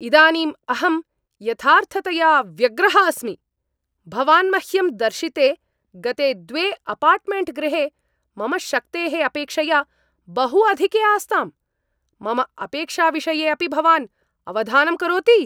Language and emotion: Sanskrit, angry